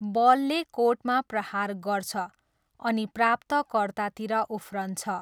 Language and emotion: Nepali, neutral